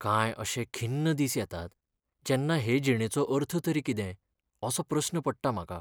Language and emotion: Goan Konkani, sad